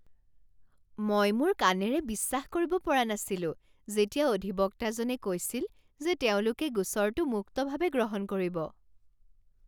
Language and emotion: Assamese, surprised